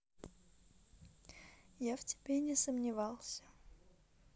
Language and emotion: Russian, neutral